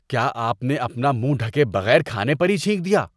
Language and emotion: Urdu, disgusted